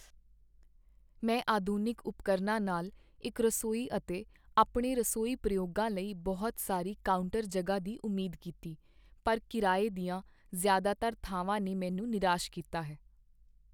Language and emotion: Punjabi, sad